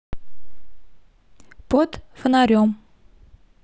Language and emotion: Russian, neutral